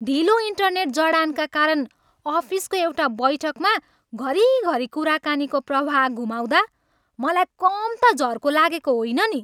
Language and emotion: Nepali, angry